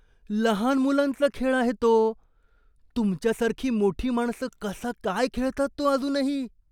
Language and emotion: Marathi, disgusted